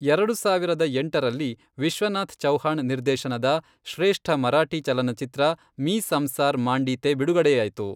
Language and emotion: Kannada, neutral